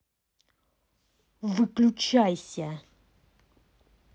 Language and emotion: Russian, angry